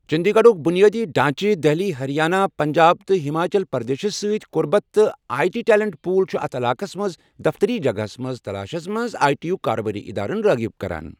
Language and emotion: Kashmiri, neutral